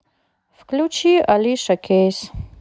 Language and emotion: Russian, sad